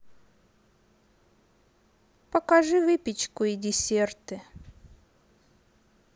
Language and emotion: Russian, neutral